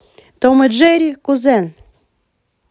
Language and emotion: Russian, positive